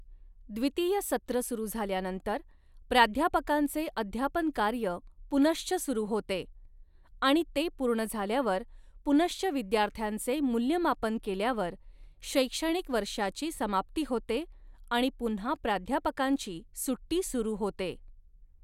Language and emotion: Marathi, neutral